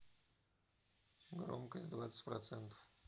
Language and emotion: Russian, neutral